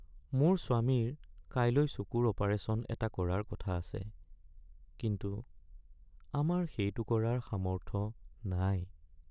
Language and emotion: Assamese, sad